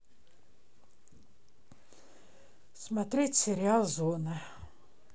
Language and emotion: Russian, neutral